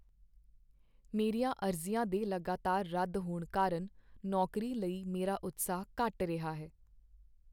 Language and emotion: Punjabi, sad